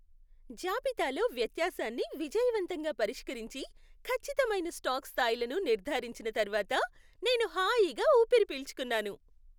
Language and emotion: Telugu, happy